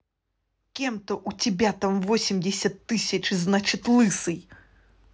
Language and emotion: Russian, angry